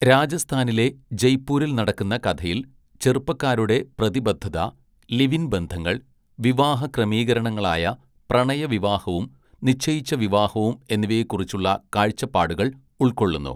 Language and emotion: Malayalam, neutral